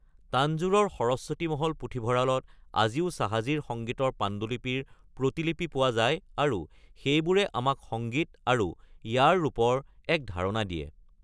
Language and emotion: Assamese, neutral